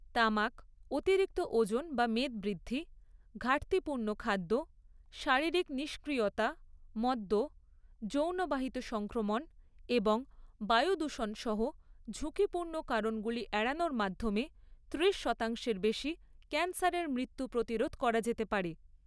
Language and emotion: Bengali, neutral